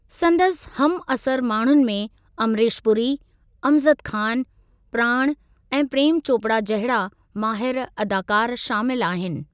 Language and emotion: Sindhi, neutral